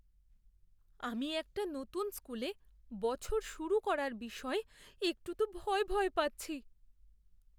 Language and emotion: Bengali, fearful